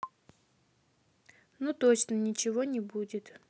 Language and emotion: Russian, neutral